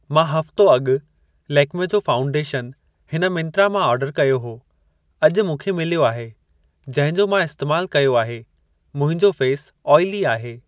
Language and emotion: Sindhi, neutral